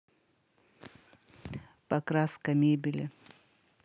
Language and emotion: Russian, neutral